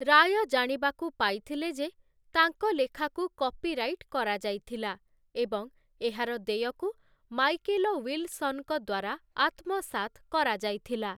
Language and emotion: Odia, neutral